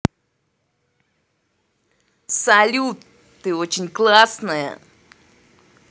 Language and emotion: Russian, positive